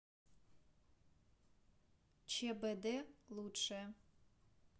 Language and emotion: Russian, neutral